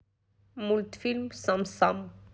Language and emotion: Russian, neutral